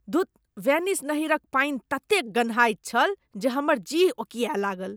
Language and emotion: Maithili, disgusted